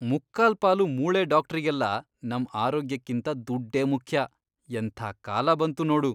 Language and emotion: Kannada, disgusted